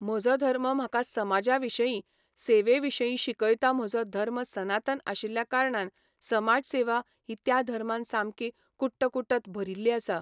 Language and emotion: Goan Konkani, neutral